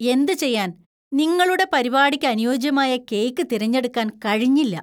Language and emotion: Malayalam, disgusted